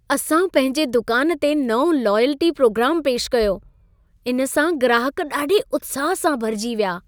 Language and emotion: Sindhi, happy